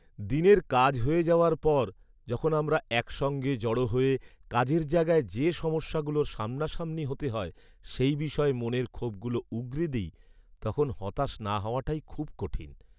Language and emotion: Bengali, sad